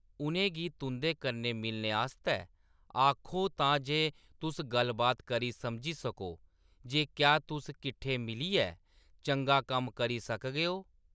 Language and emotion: Dogri, neutral